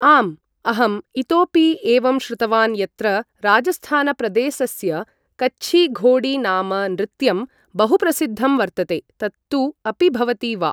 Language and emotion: Sanskrit, neutral